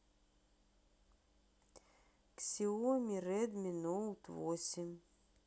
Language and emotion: Russian, neutral